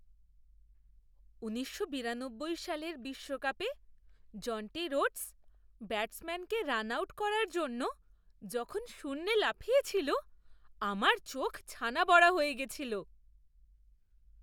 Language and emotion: Bengali, surprised